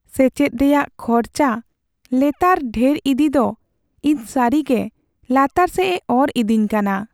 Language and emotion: Santali, sad